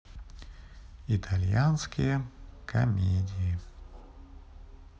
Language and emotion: Russian, neutral